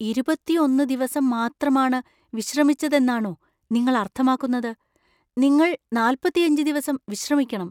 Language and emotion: Malayalam, surprised